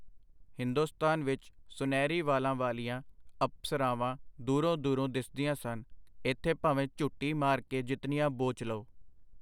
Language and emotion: Punjabi, neutral